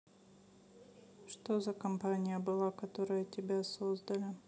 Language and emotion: Russian, neutral